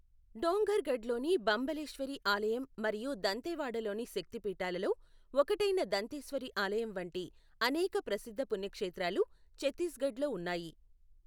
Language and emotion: Telugu, neutral